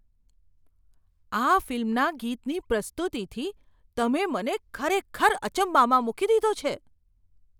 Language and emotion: Gujarati, surprised